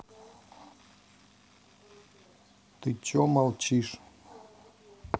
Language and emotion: Russian, neutral